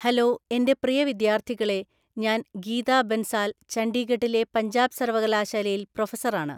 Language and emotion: Malayalam, neutral